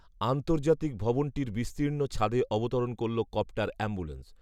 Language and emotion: Bengali, neutral